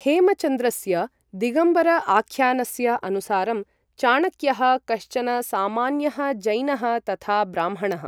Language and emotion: Sanskrit, neutral